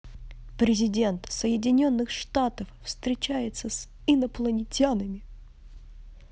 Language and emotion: Russian, positive